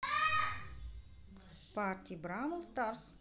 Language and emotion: Russian, neutral